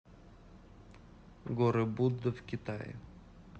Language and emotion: Russian, neutral